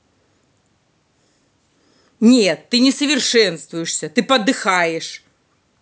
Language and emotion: Russian, angry